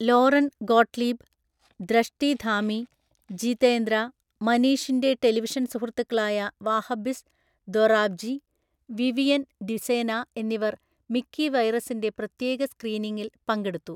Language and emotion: Malayalam, neutral